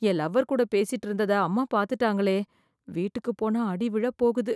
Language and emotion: Tamil, fearful